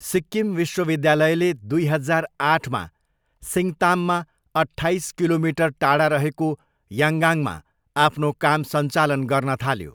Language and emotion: Nepali, neutral